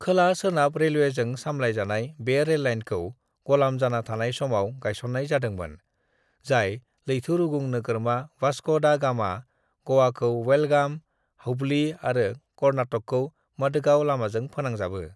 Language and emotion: Bodo, neutral